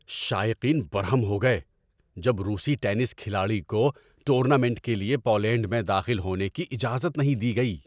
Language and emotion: Urdu, angry